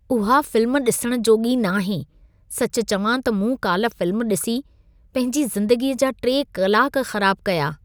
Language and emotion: Sindhi, disgusted